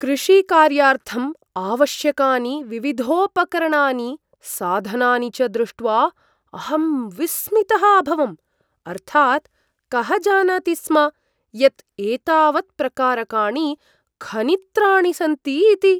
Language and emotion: Sanskrit, surprised